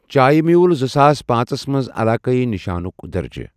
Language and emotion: Kashmiri, neutral